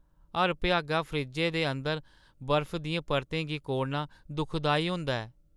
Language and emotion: Dogri, sad